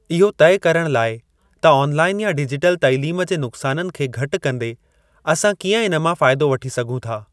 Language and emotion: Sindhi, neutral